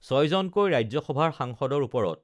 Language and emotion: Assamese, neutral